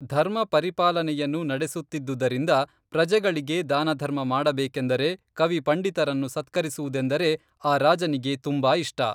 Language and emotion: Kannada, neutral